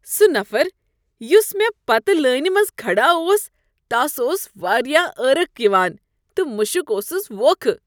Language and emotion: Kashmiri, disgusted